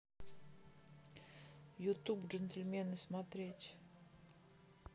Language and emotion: Russian, neutral